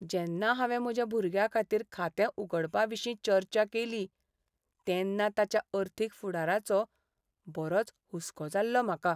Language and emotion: Goan Konkani, sad